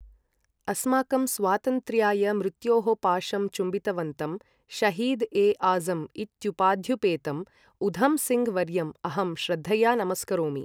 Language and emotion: Sanskrit, neutral